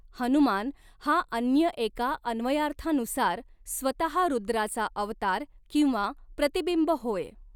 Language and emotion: Marathi, neutral